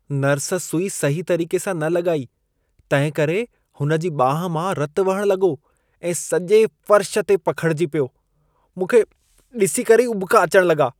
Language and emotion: Sindhi, disgusted